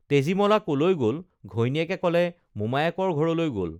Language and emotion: Assamese, neutral